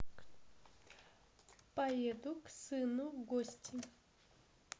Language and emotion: Russian, positive